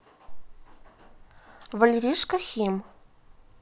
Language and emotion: Russian, neutral